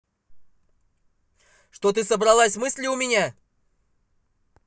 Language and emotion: Russian, angry